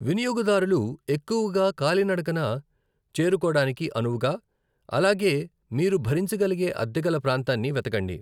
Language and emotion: Telugu, neutral